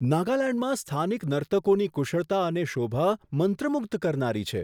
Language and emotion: Gujarati, surprised